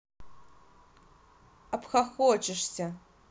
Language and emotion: Russian, angry